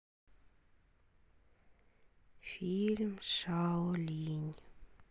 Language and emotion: Russian, sad